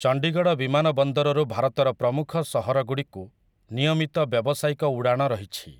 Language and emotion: Odia, neutral